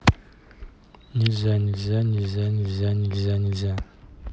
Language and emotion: Russian, neutral